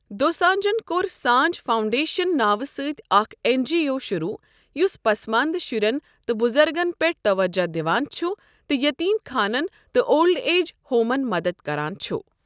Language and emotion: Kashmiri, neutral